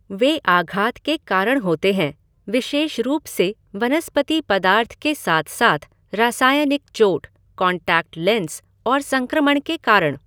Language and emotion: Hindi, neutral